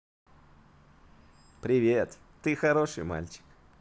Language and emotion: Russian, positive